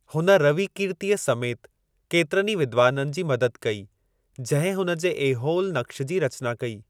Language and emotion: Sindhi, neutral